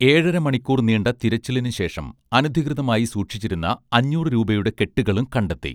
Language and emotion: Malayalam, neutral